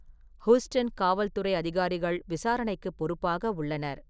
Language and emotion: Tamil, neutral